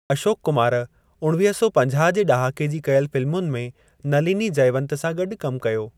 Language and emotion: Sindhi, neutral